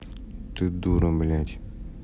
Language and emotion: Russian, angry